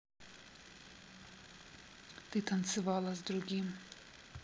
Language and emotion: Russian, neutral